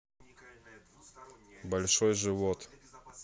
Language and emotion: Russian, neutral